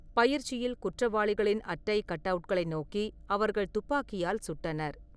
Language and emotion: Tamil, neutral